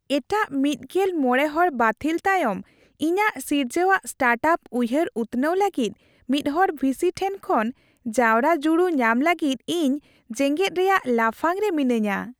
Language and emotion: Santali, happy